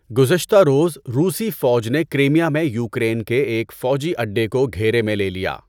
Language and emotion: Urdu, neutral